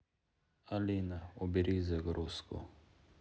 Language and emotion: Russian, sad